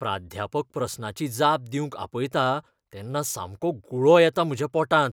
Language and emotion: Goan Konkani, fearful